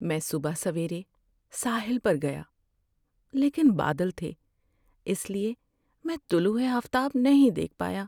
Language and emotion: Urdu, sad